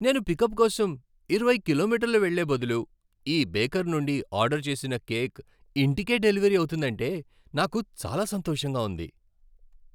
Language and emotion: Telugu, happy